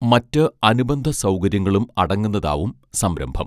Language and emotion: Malayalam, neutral